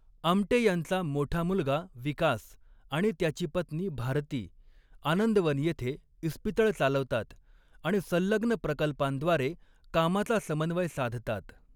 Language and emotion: Marathi, neutral